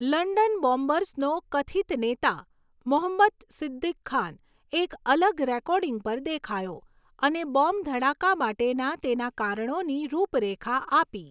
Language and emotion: Gujarati, neutral